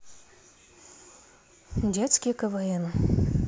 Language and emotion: Russian, neutral